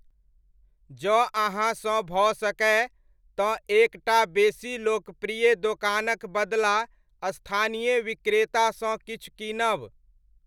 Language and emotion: Maithili, neutral